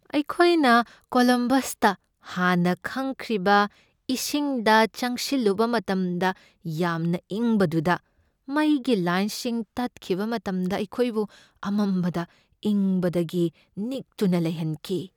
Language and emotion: Manipuri, fearful